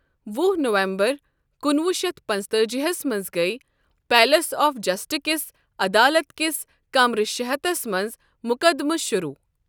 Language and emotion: Kashmiri, neutral